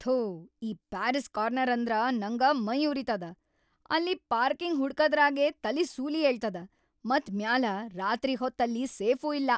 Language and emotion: Kannada, angry